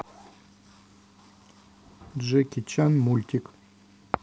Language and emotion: Russian, neutral